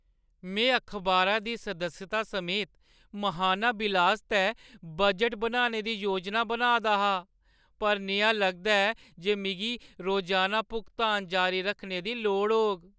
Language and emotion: Dogri, sad